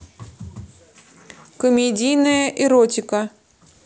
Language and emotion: Russian, neutral